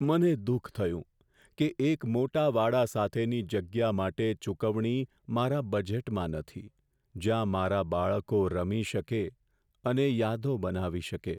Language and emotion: Gujarati, sad